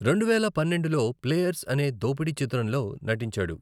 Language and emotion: Telugu, neutral